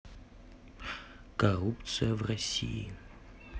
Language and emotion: Russian, neutral